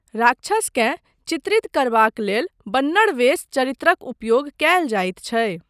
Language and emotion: Maithili, neutral